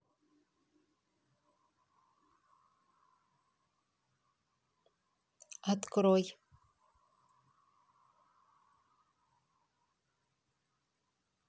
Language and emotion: Russian, neutral